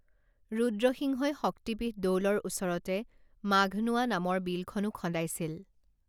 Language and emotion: Assamese, neutral